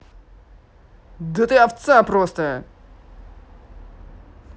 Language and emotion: Russian, angry